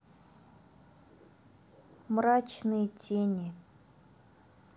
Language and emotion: Russian, neutral